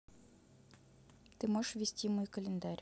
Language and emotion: Russian, neutral